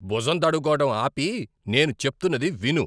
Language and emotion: Telugu, angry